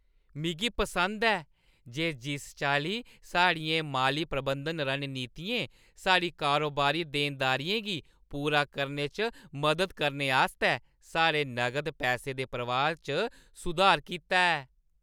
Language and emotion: Dogri, happy